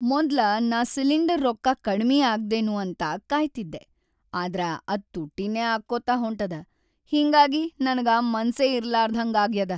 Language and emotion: Kannada, sad